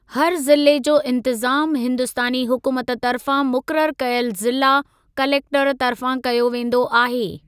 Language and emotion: Sindhi, neutral